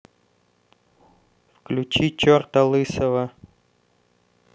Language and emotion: Russian, neutral